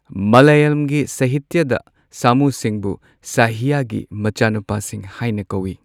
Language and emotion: Manipuri, neutral